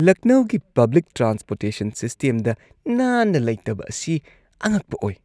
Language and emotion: Manipuri, disgusted